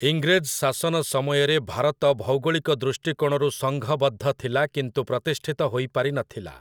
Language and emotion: Odia, neutral